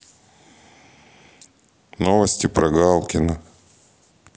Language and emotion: Russian, neutral